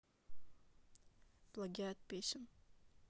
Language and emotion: Russian, neutral